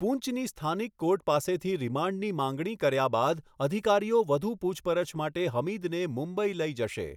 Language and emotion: Gujarati, neutral